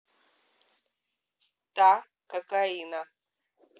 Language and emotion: Russian, neutral